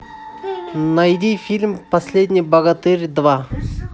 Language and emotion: Russian, neutral